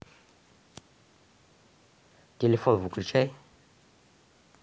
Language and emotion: Russian, neutral